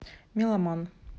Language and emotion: Russian, neutral